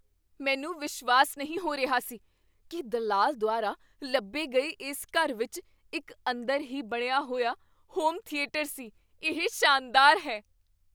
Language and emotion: Punjabi, surprised